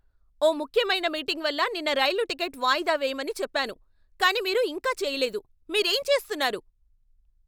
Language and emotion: Telugu, angry